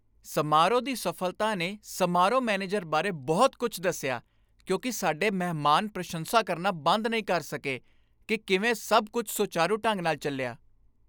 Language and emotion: Punjabi, happy